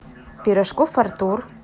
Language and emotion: Russian, neutral